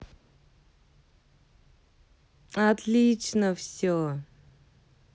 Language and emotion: Russian, positive